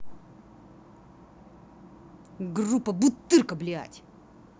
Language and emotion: Russian, angry